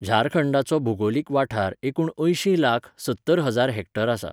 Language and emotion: Goan Konkani, neutral